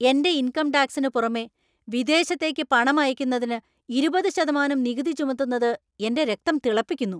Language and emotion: Malayalam, angry